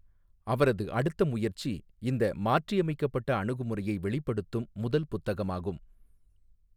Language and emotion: Tamil, neutral